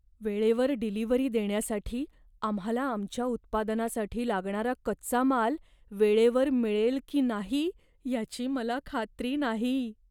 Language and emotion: Marathi, fearful